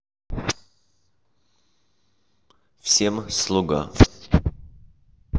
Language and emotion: Russian, neutral